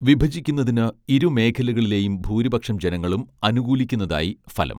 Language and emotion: Malayalam, neutral